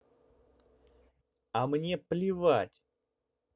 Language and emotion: Russian, angry